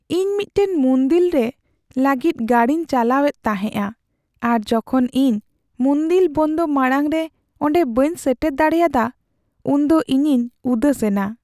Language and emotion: Santali, sad